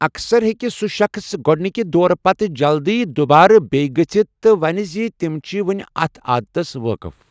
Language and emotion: Kashmiri, neutral